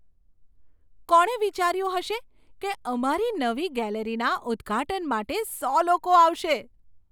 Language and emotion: Gujarati, surprised